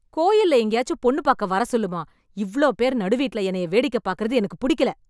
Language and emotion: Tamil, angry